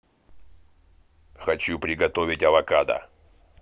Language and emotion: Russian, angry